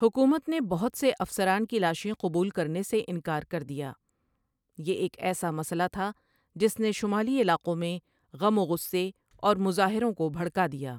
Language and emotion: Urdu, neutral